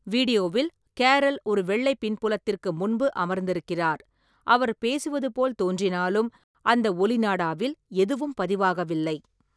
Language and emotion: Tamil, neutral